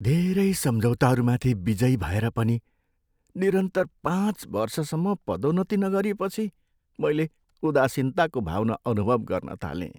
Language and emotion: Nepali, sad